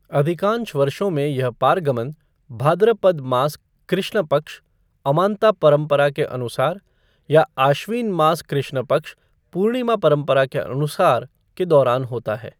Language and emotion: Hindi, neutral